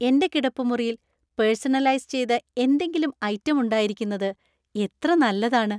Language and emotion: Malayalam, happy